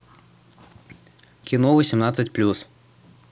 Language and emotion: Russian, neutral